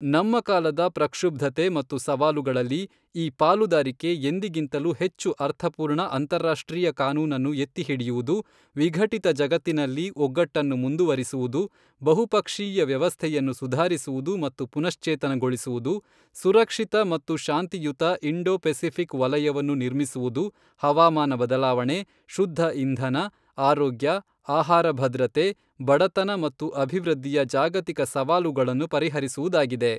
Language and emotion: Kannada, neutral